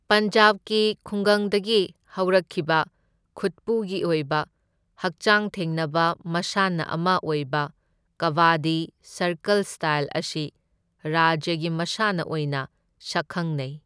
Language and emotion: Manipuri, neutral